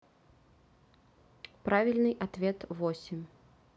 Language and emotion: Russian, neutral